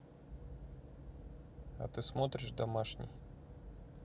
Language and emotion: Russian, neutral